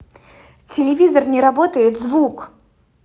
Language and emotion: Russian, angry